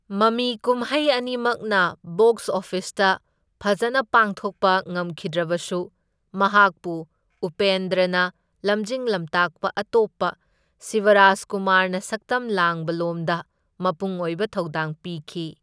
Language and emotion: Manipuri, neutral